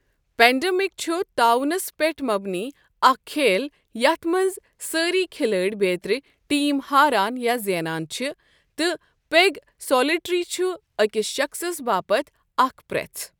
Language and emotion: Kashmiri, neutral